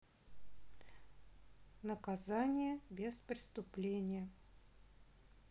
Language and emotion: Russian, neutral